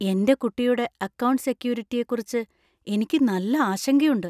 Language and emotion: Malayalam, fearful